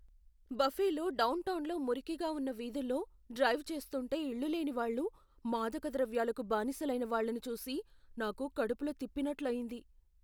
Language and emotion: Telugu, fearful